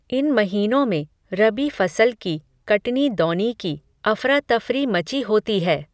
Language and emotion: Hindi, neutral